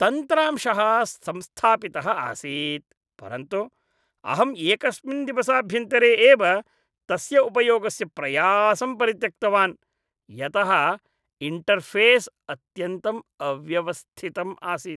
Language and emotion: Sanskrit, disgusted